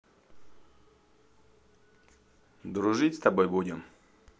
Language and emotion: Russian, neutral